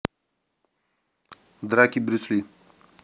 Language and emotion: Russian, neutral